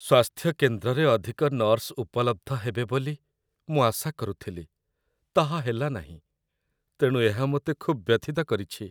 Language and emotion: Odia, sad